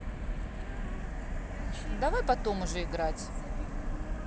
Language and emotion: Russian, neutral